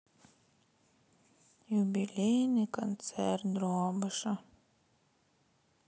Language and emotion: Russian, sad